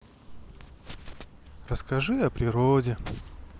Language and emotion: Russian, sad